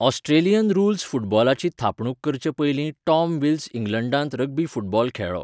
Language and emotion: Goan Konkani, neutral